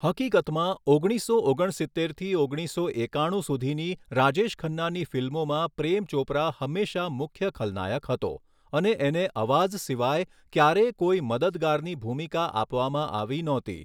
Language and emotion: Gujarati, neutral